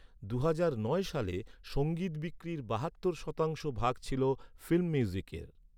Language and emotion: Bengali, neutral